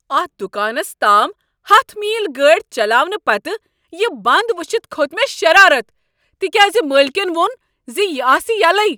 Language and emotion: Kashmiri, angry